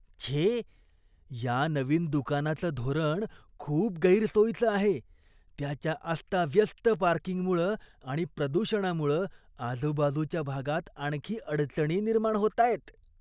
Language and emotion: Marathi, disgusted